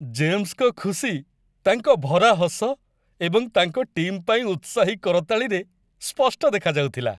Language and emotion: Odia, happy